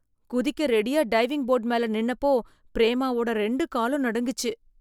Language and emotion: Tamil, fearful